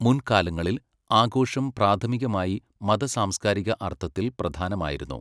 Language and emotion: Malayalam, neutral